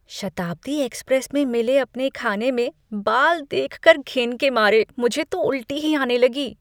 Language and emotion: Hindi, disgusted